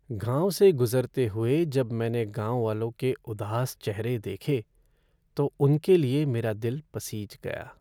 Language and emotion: Hindi, sad